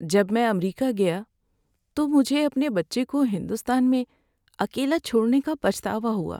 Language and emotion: Urdu, sad